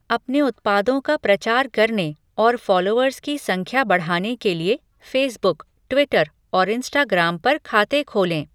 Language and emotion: Hindi, neutral